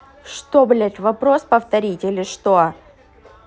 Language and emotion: Russian, angry